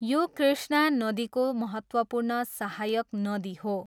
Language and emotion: Nepali, neutral